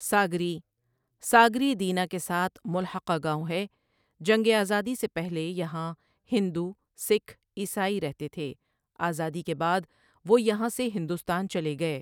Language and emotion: Urdu, neutral